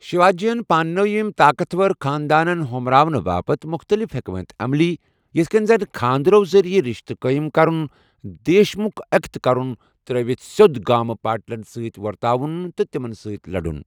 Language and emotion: Kashmiri, neutral